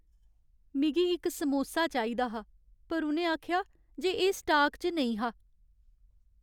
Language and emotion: Dogri, sad